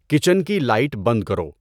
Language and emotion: Urdu, neutral